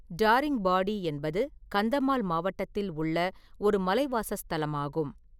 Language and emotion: Tamil, neutral